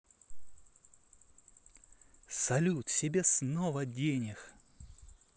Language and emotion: Russian, positive